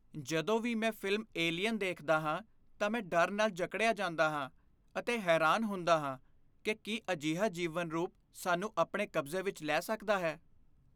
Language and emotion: Punjabi, fearful